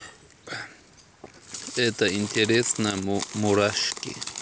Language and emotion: Russian, neutral